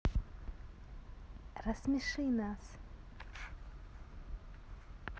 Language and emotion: Russian, neutral